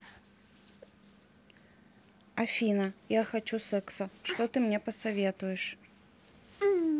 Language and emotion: Russian, neutral